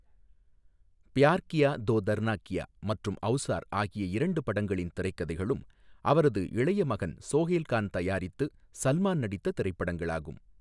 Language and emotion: Tamil, neutral